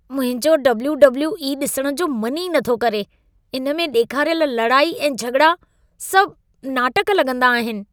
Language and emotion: Sindhi, disgusted